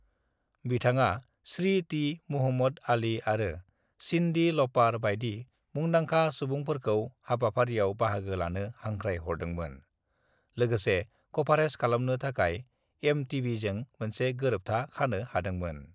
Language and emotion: Bodo, neutral